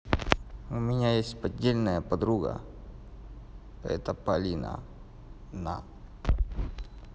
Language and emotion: Russian, neutral